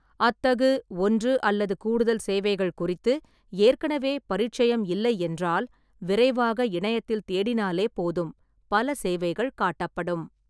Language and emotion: Tamil, neutral